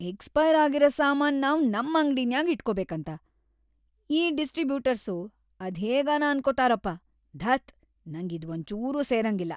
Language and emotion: Kannada, disgusted